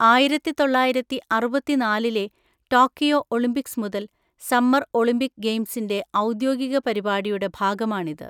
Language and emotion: Malayalam, neutral